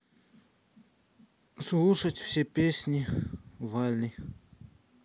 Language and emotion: Russian, neutral